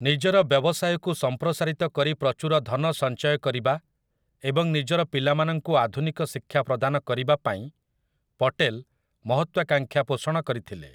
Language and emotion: Odia, neutral